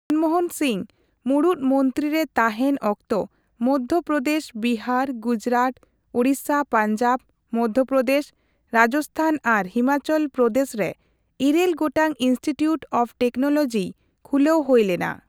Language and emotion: Santali, neutral